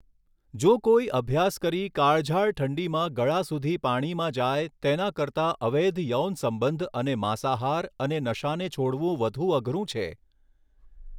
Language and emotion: Gujarati, neutral